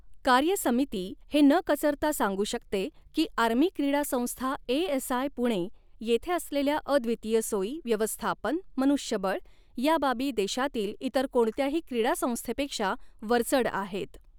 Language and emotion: Marathi, neutral